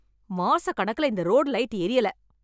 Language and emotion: Tamil, angry